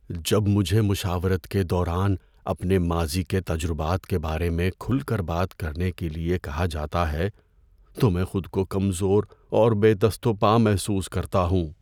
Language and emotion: Urdu, fearful